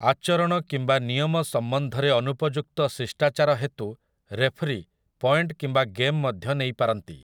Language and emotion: Odia, neutral